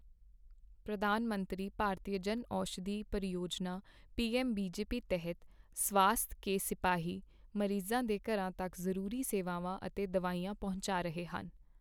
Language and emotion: Punjabi, neutral